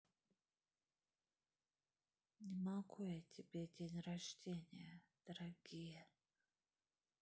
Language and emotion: Russian, neutral